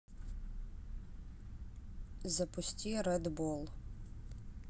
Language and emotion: Russian, neutral